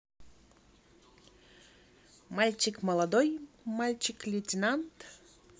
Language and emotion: Russian, positive